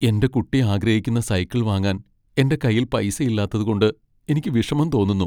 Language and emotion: Malayalam, sad